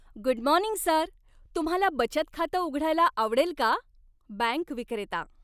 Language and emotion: Marathi, happy